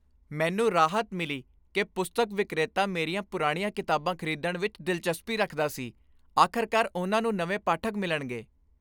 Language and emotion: Punjabi, happy